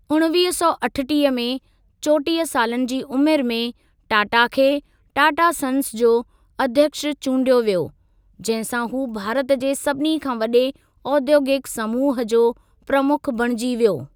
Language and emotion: Sindhi, neutral